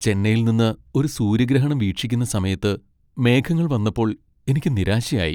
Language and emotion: Malayalam, sad